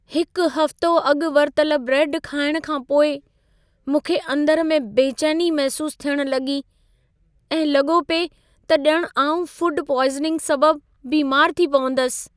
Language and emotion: Sindhi, fearful